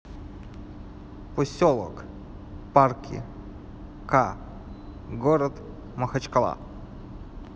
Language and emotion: Russian, neutral